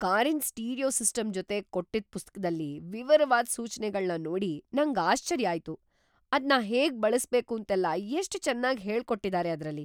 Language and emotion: Kannada, surprised